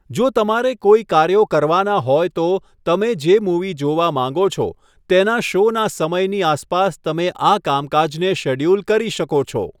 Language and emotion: Gujarati, neutral